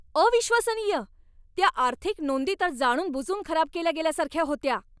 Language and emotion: Marathi, angry